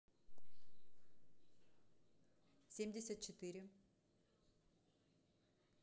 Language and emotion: Russian, neutral